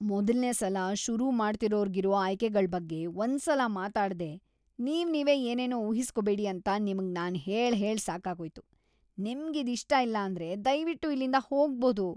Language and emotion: Kannada, disgusted